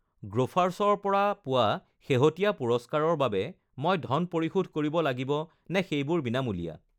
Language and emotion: Assamese, neutral